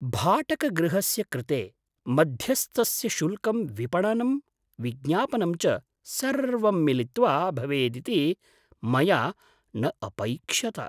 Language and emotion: Sanskrit, surprised